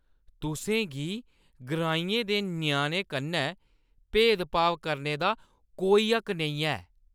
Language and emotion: Dogri, angry